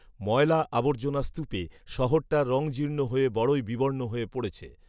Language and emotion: Bengali, neutral